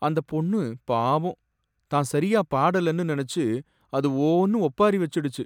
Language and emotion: Tamil, sad